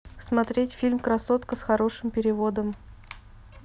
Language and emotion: Russian, neutral